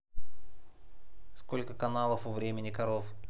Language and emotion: Russian, neutral